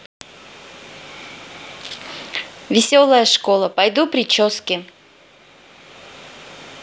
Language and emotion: Russian, positive